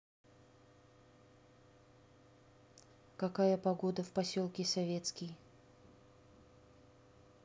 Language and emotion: Russian, neutral